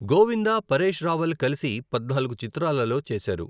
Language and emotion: Telugu, neutral